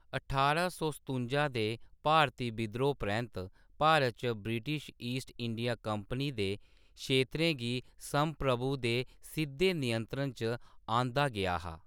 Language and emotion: Dogri, neutral